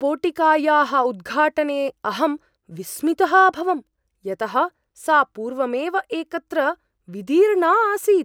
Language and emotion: Sanskrit, surprised